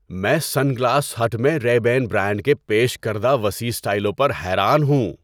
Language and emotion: Urdu, surprised